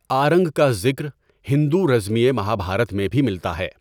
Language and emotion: Urdu, neutral